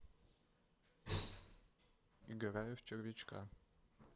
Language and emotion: Russian, neutral